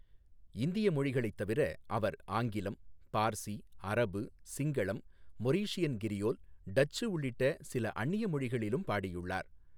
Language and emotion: Tamil, neutral